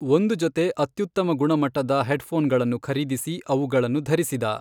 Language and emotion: Kannada, neutral